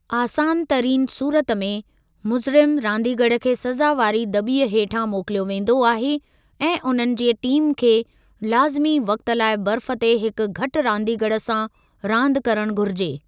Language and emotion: Sindhi, neutral